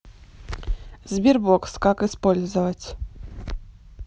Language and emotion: Russian, neutral